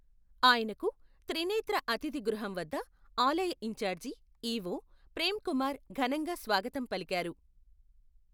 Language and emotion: Telugu, neutral